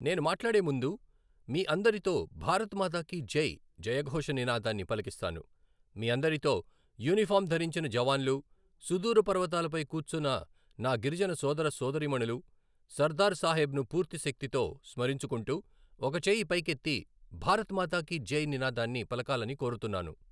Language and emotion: Telugu, neutral